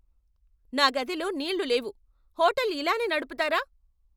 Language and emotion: Telugu, angry